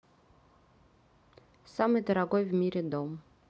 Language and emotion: Russian, neutral